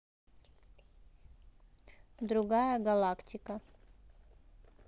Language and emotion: Russian, neutral